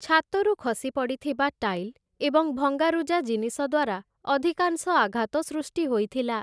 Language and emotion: Odia, neutral